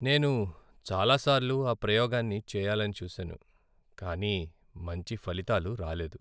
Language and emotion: Telugu, sad